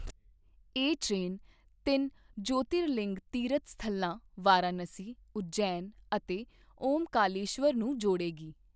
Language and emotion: Punjabi, neutral